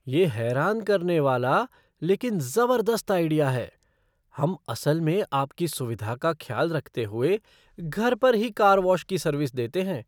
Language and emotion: Hindi, surprised